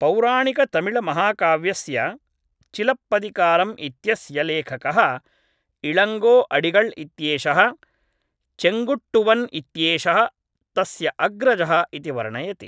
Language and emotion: Sanskrit, neutral